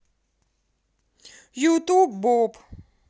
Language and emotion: Russian, positive